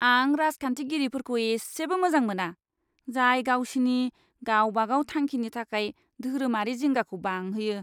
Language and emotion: Bodo, disgusted